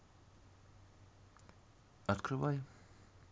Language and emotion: Russian, neutral